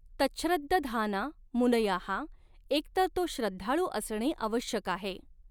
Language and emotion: Marathi, neutral